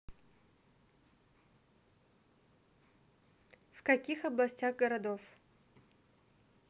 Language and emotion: Russian, neutral